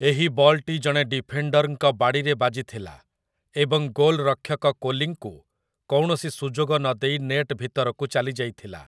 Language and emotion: Odia, neutral